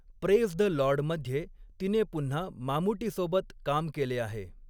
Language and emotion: Marathi, neutral